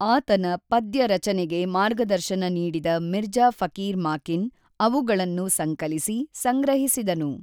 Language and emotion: Kannada, neutral